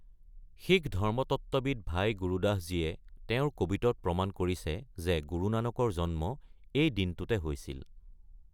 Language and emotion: Assamese, neutral